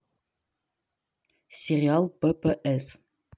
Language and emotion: Russian, neutral